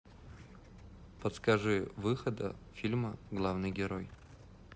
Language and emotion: Russian, neutral